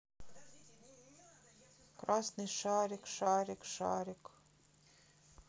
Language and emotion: Russian, sad